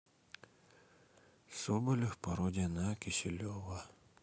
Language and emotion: Russian, sad